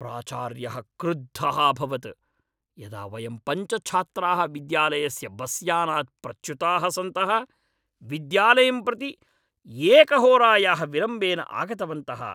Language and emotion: Sanskrit, angry